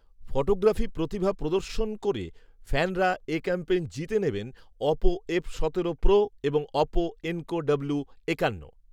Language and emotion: Bengali, neutral